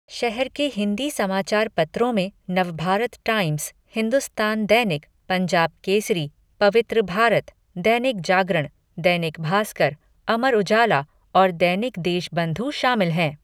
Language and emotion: Hindi, neutral